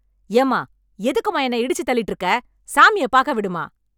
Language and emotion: Tamil, angry